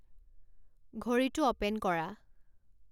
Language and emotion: Assamese, neutral